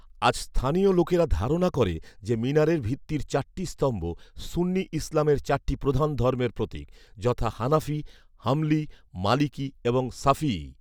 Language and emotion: Bengali, neutral